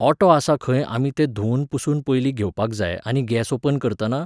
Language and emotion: Goan Konkani, neutral